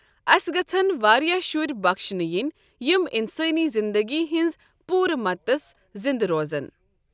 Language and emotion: Kashmiri, neutral